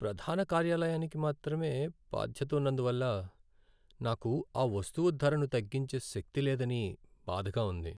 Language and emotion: Telugu, sad